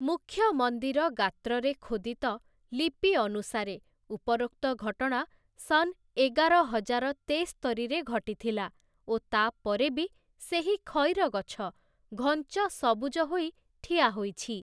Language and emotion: Odia, neutral